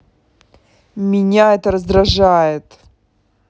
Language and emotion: Russian, angry